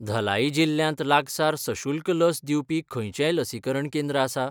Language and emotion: Goan Konkani, neutral